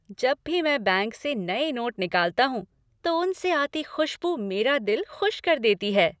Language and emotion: Hindi, happy